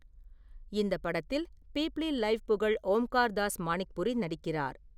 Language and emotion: Tamil, neutral